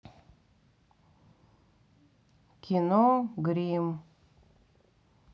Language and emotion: Russian, neutral